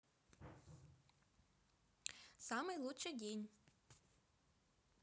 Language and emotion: Russian, positive